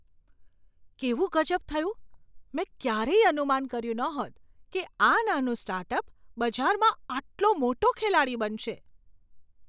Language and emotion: Gujarati, surprised